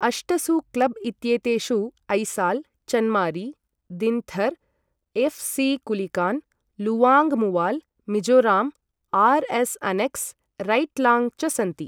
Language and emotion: Sanskrit, neutral